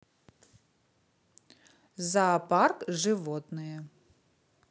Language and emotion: Russian, positive